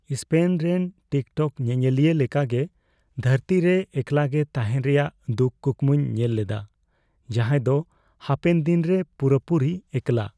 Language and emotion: Santali, fearful